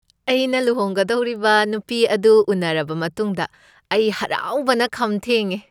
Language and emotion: Manipuri, happy